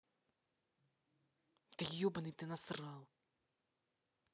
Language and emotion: Russian, angry